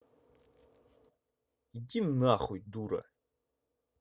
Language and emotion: Russian, angry